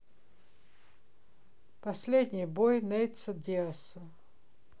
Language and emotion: Russian, neutral